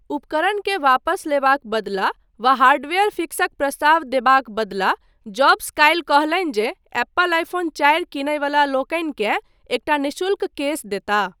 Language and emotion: Maithili, neutral